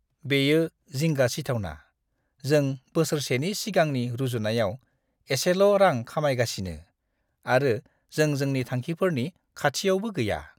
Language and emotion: Bodo, disgusted